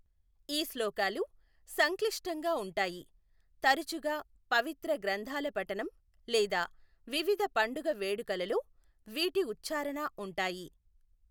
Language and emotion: Telugu, neutral